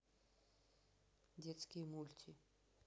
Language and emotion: Russian, neutral